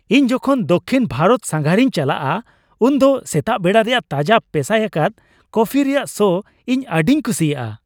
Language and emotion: Santali, happy